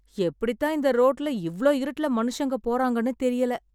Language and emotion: Tamil, surprised